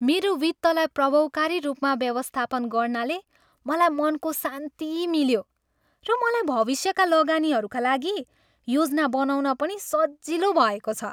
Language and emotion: Nepali, happy